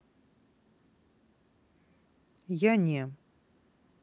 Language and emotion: Russian, neutral